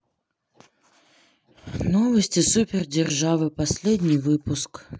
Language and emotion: Russian, sad